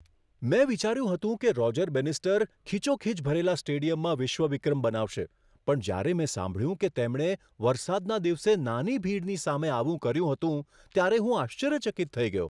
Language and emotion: Gujarati, surprised